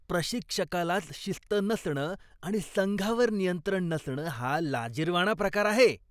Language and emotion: Marathi, disgusted